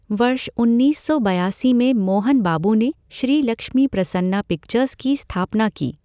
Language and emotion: Hindi, neutral